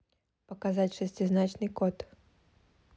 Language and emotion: Russian, neutral